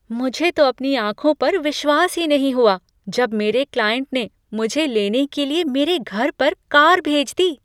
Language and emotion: Hindi, surprised